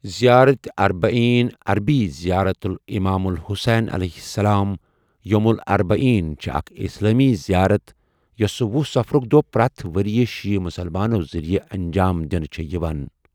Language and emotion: Kashmiri, neutral